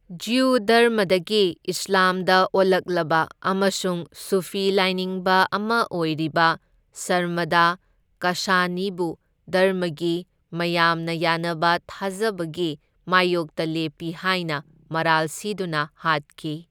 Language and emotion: Manipuri, neutral